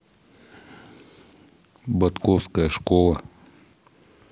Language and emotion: Russian, neutral